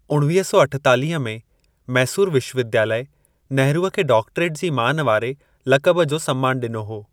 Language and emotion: Sindhi, neutral